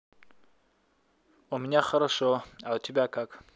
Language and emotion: Russian, positive